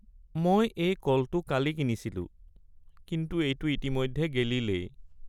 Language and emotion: Assamese, sad